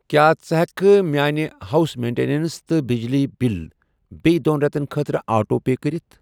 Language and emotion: Kashmiri, neutral